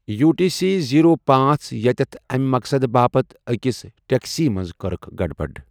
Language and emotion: Kashmiri, neutral